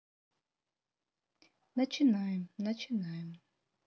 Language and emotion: Russian, neutral